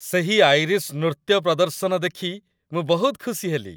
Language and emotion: Odia, happy